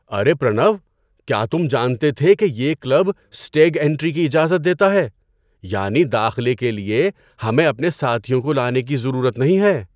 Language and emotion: Urdu, surprised